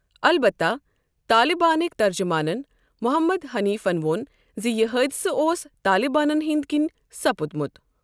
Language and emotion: Kashmiri, neutral